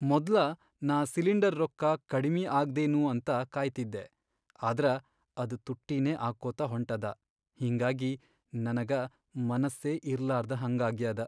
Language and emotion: Kannada, sad